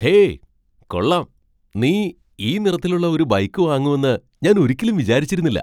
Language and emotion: Malayalam, surprised